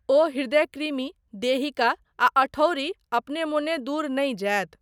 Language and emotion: Maithili, neutral